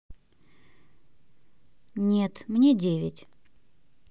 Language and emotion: Russian, neutral